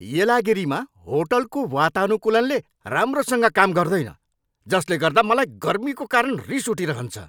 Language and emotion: Nepali, angry